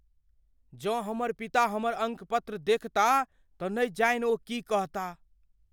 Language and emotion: Maithili, fearful